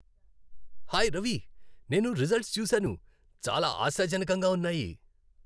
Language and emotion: Telugu, happy